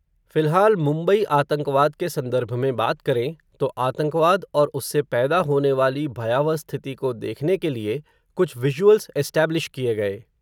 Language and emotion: Hindi, neutral